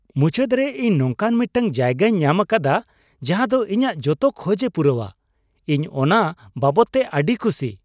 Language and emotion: Santali, happy